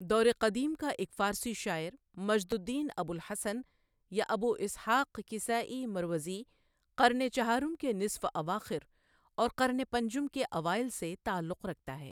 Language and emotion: Urdu, neutral